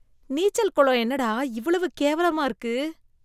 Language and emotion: Tamil, disgusted